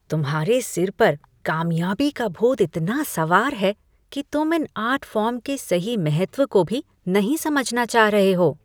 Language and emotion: Hindi, disgusted